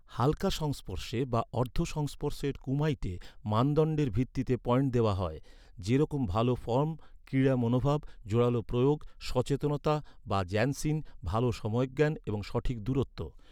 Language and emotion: Bengali, neutral